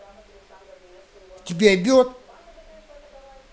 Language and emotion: Russian, angry